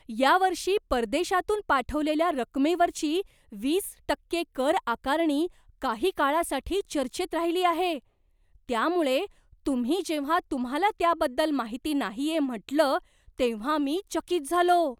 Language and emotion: Marathi, surprised